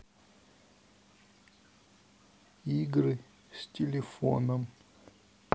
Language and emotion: Russian, neutral